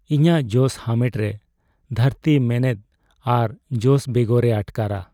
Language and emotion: Santali, sad